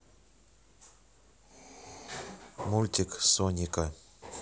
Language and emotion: Russian, neutral